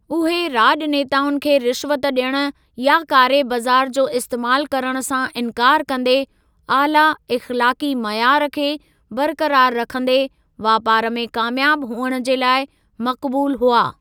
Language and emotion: Sindhi, neutral